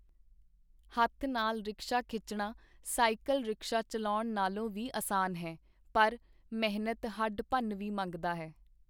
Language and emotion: Punjabi, neutral